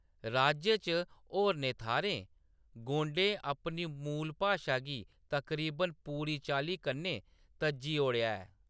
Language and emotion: Dogri, neutral